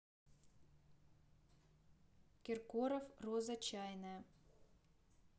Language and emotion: Russian, neutral